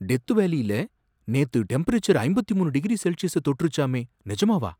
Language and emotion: Tamil, surprised